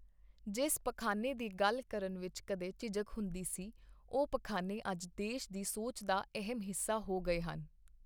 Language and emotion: Punjabi, neutral